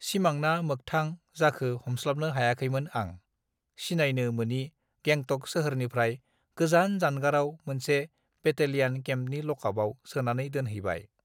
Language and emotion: Bodo, neutral